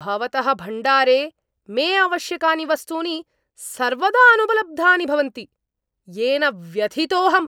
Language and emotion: Sanskrit, angry